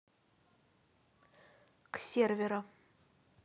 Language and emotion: Russian, neutral